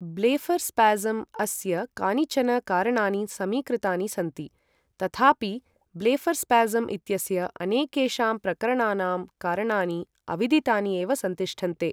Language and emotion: Sanskrit, neutral